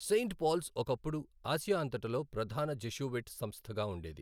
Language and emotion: Telugu, neutral